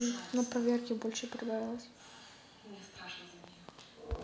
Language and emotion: Russian, sad